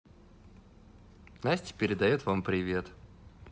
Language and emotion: Russian, positive